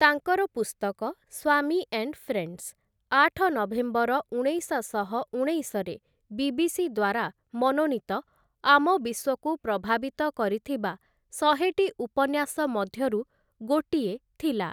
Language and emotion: Odia, neutral